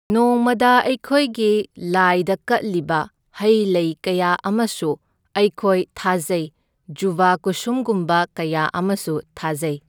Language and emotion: Manipuri, neutral